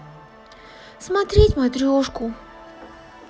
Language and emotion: Russian, sad